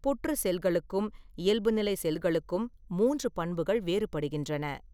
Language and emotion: Tamil, neutral